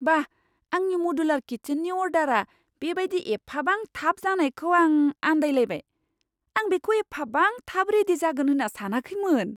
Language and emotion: Bodo, surprised